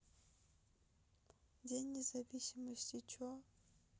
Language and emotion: Russian, sad